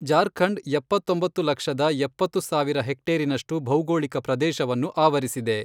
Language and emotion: Kannada, neutral